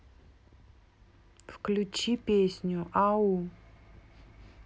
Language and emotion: Russian, neutral